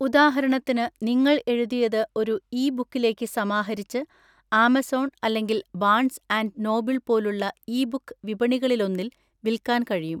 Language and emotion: Malayalam, neutral